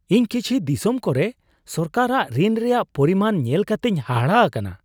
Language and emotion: Santali, surprised